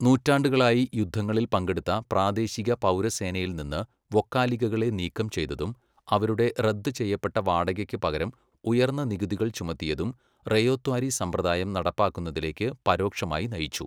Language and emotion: Malayalam, neutral